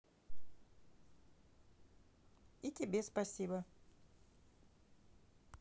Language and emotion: Russian, neutral